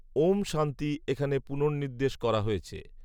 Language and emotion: Bengali, neutral